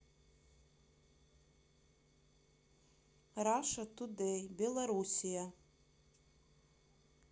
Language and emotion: Russian, neutral